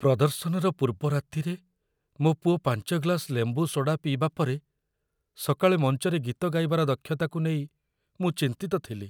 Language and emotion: Odia, fearful